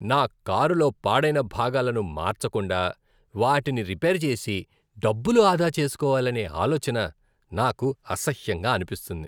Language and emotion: Telugu, disgusted